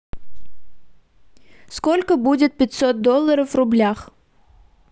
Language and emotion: Russian, neutral